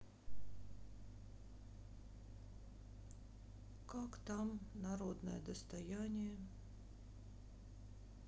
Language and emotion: Russian, sad